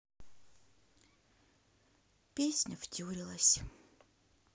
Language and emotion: Russian, sad